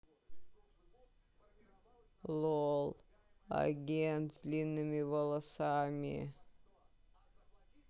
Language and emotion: Russian, sad